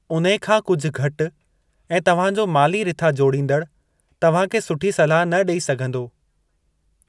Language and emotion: Sindhi, neutral